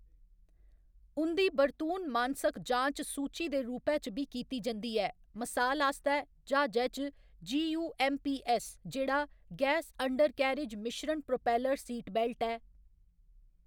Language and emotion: Dogri, neutral